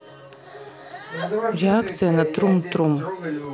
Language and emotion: Russian, neutral